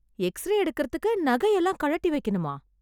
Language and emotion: Tamil, surprised